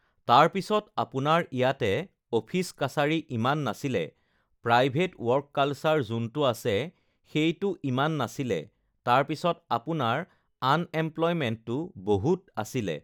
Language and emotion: Assamese, neutral